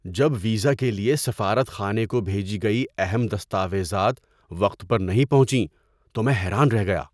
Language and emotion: Urdu, surprised